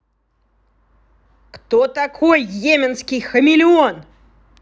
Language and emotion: Russian, angry